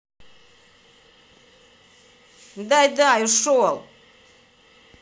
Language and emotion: Russian, angry